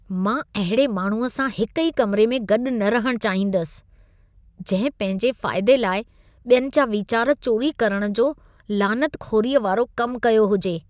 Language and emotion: Sindhi, disgusted